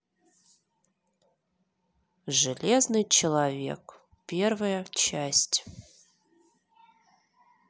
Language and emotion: Russian, neutral